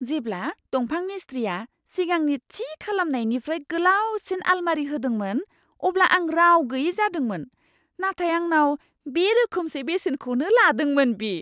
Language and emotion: Bodo, surprised